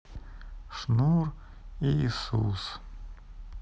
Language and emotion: Russian, sad